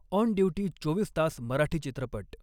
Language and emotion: Marathi, neutral